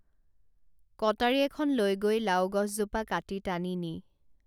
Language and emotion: Assamese, neutral